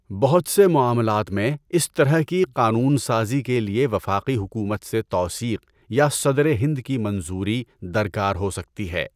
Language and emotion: Urdu, neutral